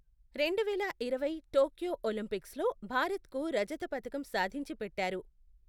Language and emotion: Telugu, neutral